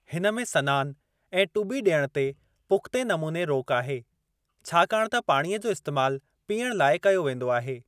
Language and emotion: Sindhi, neutral